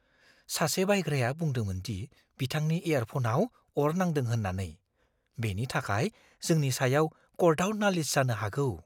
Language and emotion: Bodo, fearful